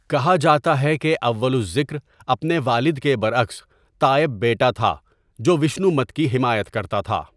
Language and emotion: Urdu, neutral